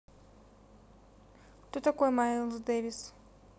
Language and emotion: Russian, neutral